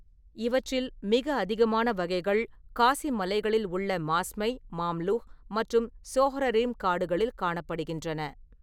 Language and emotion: Tamil, neutral